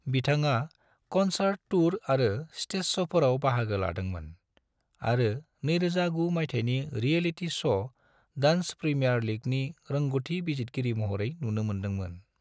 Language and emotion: Bodo, neutral